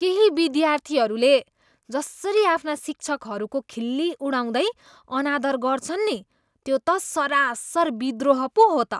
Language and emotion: Nepali, disgusted